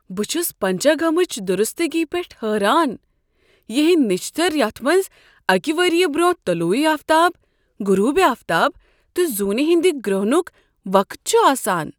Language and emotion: Kashmiri, surprised